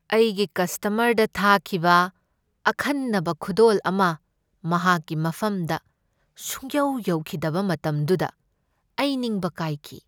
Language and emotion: Manipuri, sad